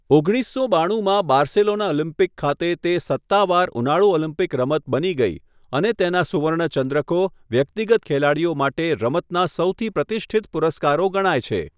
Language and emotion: Gujarati, neutral